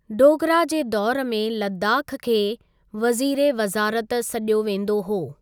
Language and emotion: Sindhi, neutral